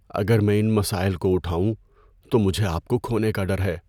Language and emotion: Urdu, fearful